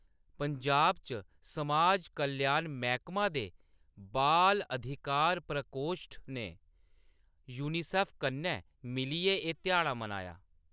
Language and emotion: Dogri, neutral